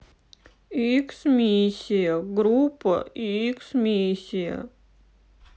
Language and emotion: Russian, sad